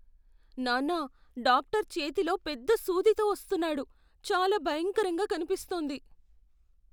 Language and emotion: Telugu, fearful